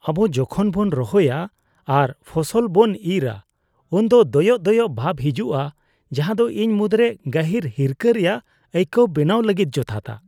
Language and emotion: Santali, disgusted